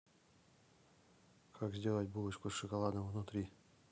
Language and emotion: Russian, neutral